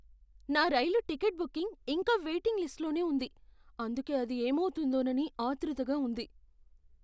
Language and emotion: Telugu, fearful